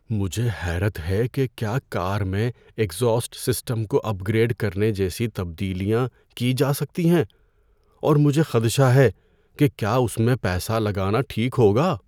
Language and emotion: Urdu, fearful